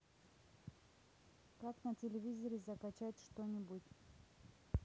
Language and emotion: Russian, neutral